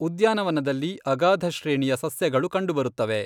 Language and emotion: Kannada, neutral